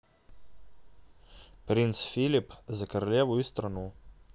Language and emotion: Russian, neutral